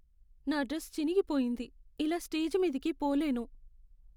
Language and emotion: Telugu, sad